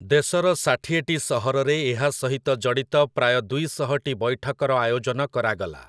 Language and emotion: Odia, neutral